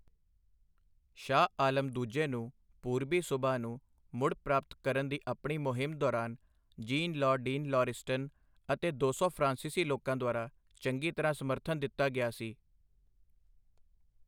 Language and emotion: Punjabi, neutral